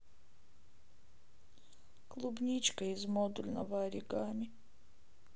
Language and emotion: Russian, sad